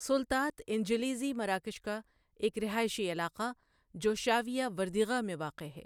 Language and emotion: Urdu, neutral